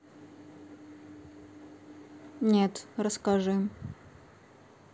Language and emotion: Russian, neutral